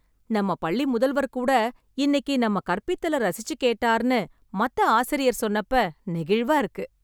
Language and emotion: Tamil, happy